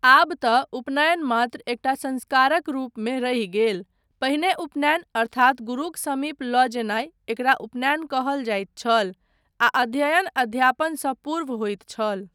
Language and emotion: Maithili, neutral